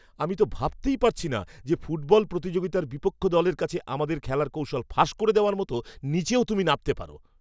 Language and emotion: Bengali, angry